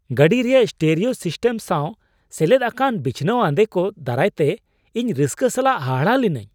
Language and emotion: Santali, surprised